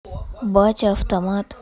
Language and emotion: Russian, neutral